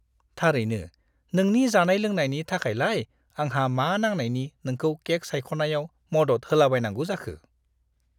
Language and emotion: Bodo, disgusted